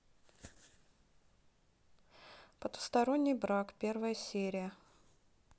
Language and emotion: Russian, neutral